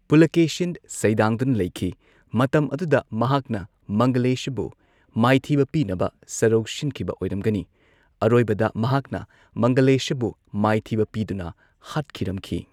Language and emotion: Manipuri, neutral